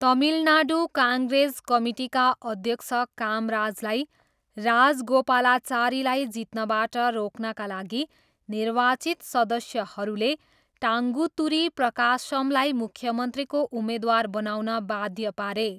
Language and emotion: Nepali, neutral